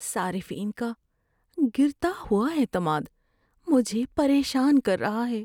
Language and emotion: Urdu, fearful